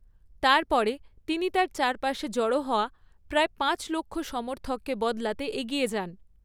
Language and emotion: Bengali, neutral